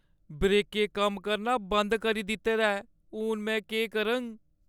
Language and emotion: Dogri, fearful